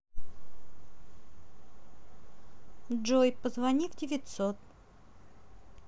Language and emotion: Russian, neutral